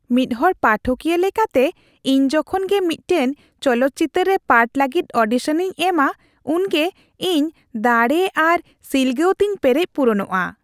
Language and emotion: Santali, happy